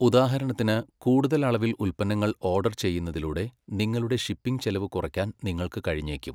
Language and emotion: Malayalam, neutral